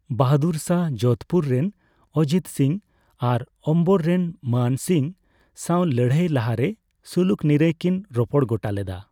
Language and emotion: Santali, neutral